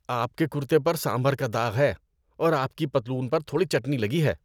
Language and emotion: Urdu, disgusted